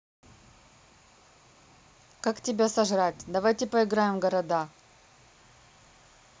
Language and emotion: Russian, neutral